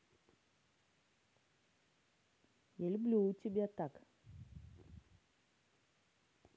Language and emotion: Russian, positive